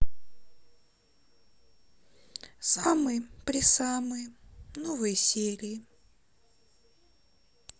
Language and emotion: Russian, sad